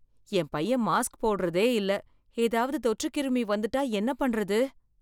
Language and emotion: Tamil, fearful